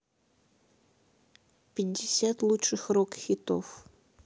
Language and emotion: Russian, neutral